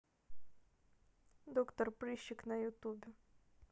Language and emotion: Russian, neutral